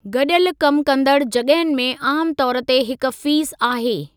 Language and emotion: Sindhi, neutral